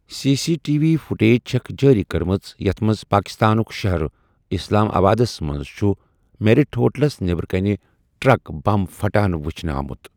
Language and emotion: Kashmiri, neutral